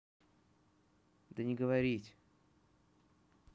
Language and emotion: Russian, neutral